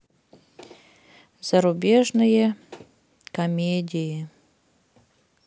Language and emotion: Russian, sad